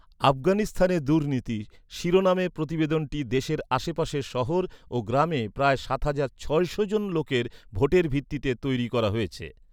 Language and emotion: Bengali, neutral